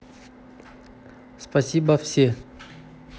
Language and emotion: Russian, neutral